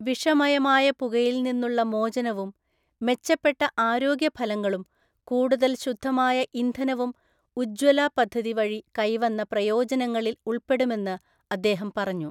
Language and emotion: Malayalam, neutral